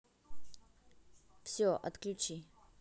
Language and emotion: Russian, neutral